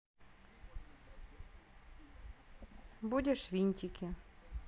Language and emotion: Russian, neutral